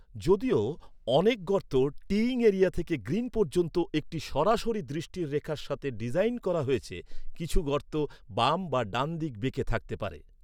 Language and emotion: Bengali, neutral